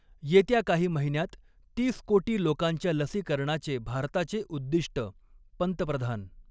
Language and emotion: Marathi, neutral